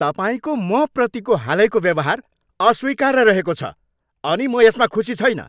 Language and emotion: Nepali, angry